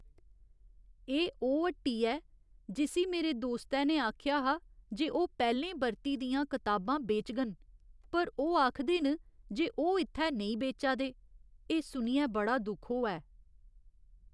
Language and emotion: Dogri, sad